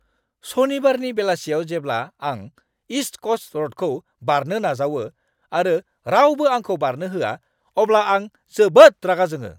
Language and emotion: Bodo, angry